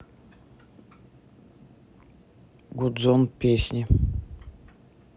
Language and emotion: Russian, neutral